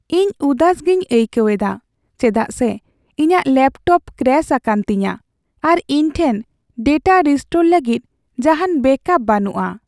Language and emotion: Santali, sad